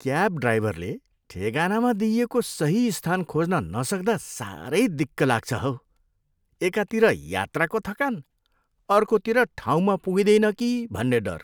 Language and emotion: Nepali, disgusted